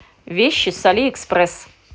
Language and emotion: Russian, positive